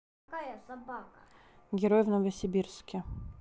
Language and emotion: Russian, neutral